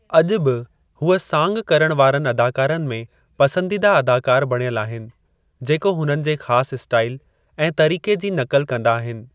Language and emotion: Sindhi, neutral